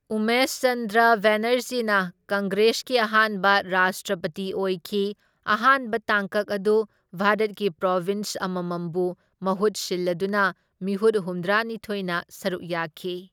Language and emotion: Manipuri, neutral